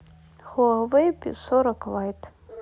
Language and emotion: Russian, neutral